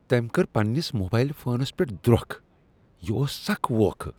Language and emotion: Kashmiri, disgusted